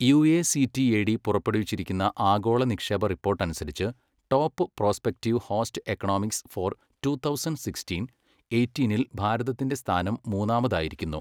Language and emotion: Malayalam, neutral